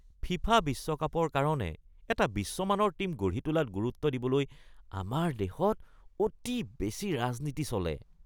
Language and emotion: Assamese, disgusted